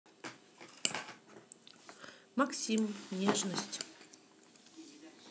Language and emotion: Russian, neutral